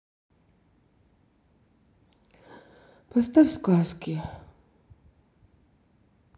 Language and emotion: Russian, sad